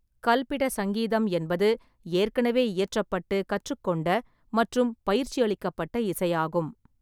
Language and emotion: Tamil, neutral